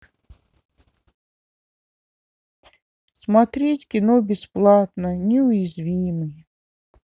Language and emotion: Russian, sad